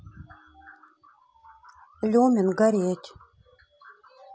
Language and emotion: Russian, neutral